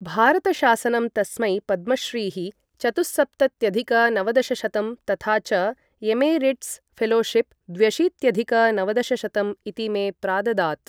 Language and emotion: Sanskrit, neutral